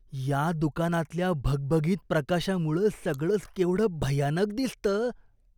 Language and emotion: Marathi, disgusted